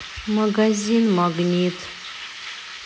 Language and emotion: Russian, sad